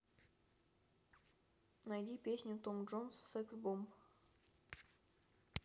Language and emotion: Russian, neutral